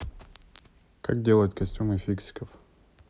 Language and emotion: Russian, neutral